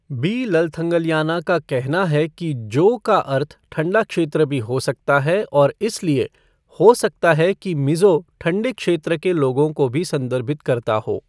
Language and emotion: Hindi, neutral